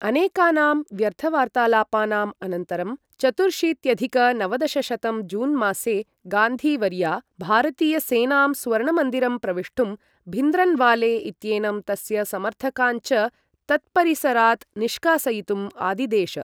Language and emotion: Sanskrit, neutral